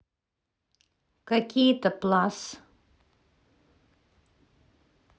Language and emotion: Russian, neutral